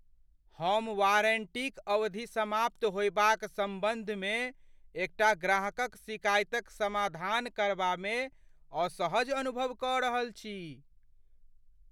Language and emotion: Maithili, fearful